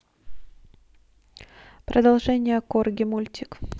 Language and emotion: Russian, neutral